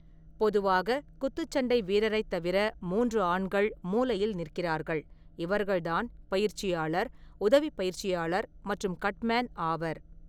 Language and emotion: Tamil, neutral